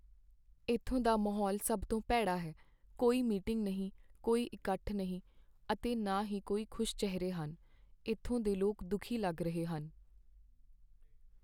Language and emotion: Punjabi, sad